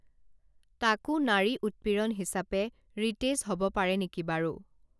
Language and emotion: Assamese, neutral